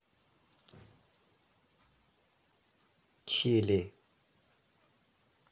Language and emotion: Russian, neutral